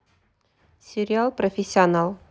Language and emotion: Russian, neutral